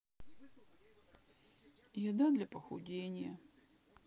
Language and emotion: Russian, sad